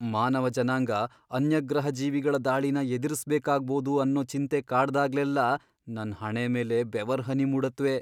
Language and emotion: Kannada, fearful